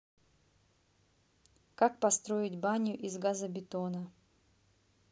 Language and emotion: Russian, neutral